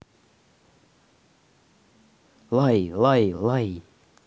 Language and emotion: Russian, neutral